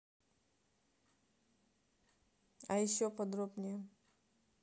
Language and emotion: Russian, neutral